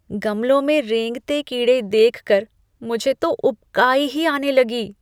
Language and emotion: Hindi, disgusted